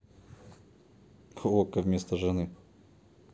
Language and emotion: Russian, neutral